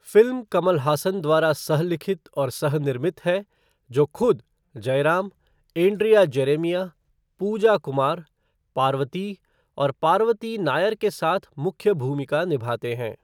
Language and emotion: Hindi, neutral